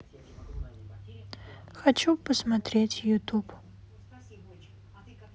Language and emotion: Russian, neutral